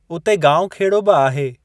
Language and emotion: Sindhi, neutral